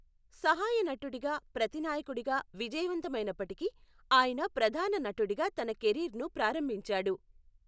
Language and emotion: Telugu, neutral